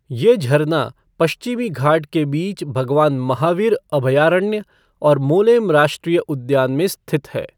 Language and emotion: Hindi, neutral